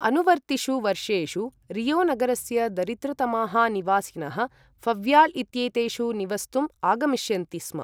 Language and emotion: Sanskrit, neutral